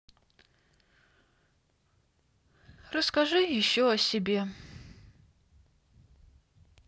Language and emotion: Russian, sad